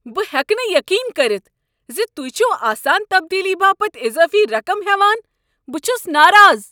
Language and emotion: Kashmiri, angry